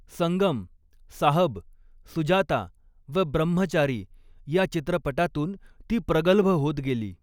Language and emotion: Marathi, neutral